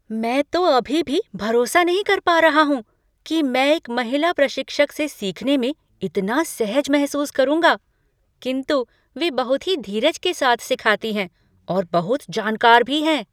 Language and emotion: Hindi, surprised